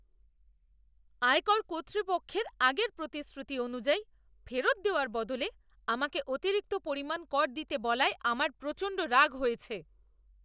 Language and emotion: Bengali, angry